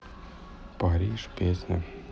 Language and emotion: Russian, neutral